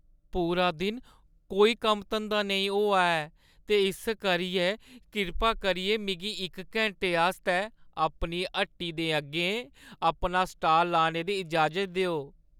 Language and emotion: Dogri, sad